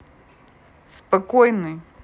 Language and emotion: Russian, neutral